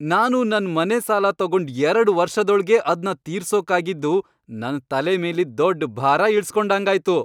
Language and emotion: Kannada, happy